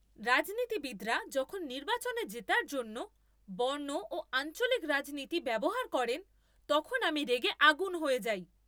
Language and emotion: Bengali, angry